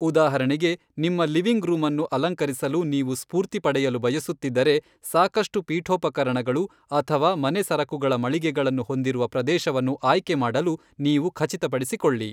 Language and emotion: Kannada, neutral